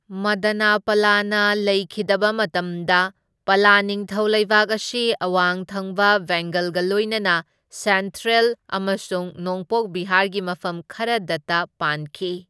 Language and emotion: Manipuri, neutral